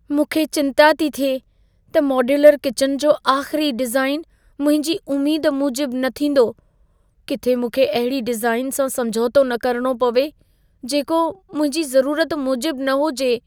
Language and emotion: Sindhi, fearful